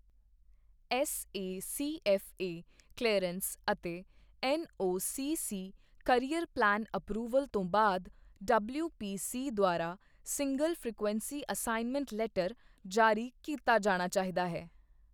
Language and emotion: Punjabi, neutral